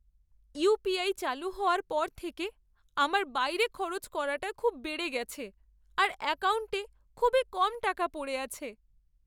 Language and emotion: Bengali, sad